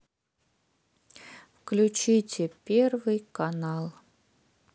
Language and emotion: Russian, sad